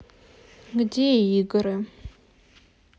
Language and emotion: Russian, neutral